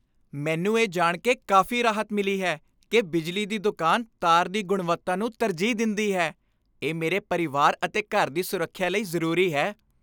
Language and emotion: Punjabi, happy